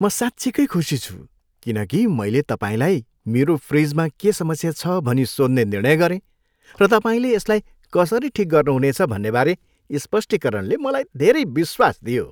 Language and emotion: Nepali, happy